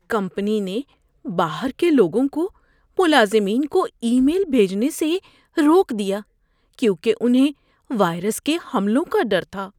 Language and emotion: Urdu, fearful